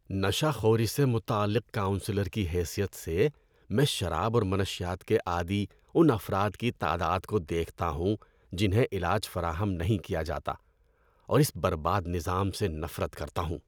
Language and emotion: Urdu, disgusted